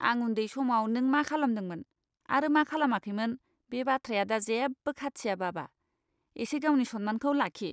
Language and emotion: Bodo, disgusted